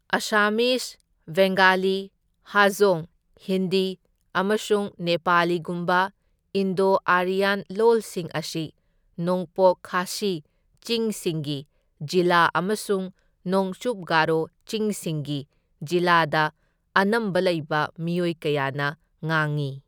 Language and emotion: Manipuri, neutral